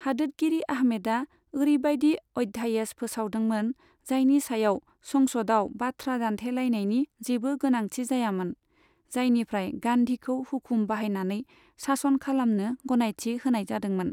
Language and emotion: Bodo, neutral